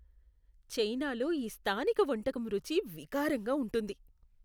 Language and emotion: Telugu, disgusted